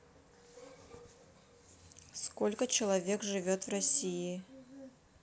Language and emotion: Russian, neutral